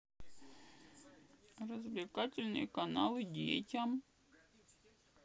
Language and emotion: Russian, sad